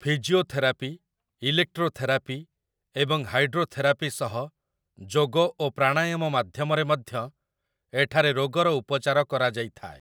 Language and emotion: Odia, neutral